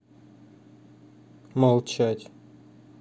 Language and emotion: Russian, neutral